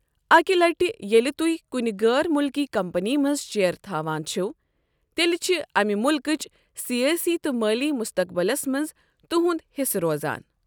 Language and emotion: Kashmiri, neutral